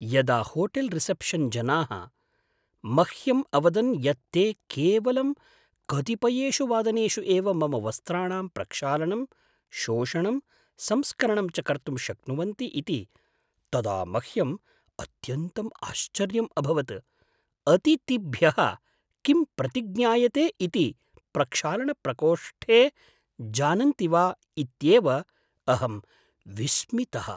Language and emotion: Sanskrit, surprised